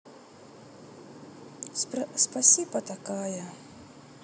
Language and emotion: Russian, sad